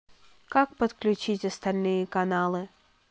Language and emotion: Russian, neutral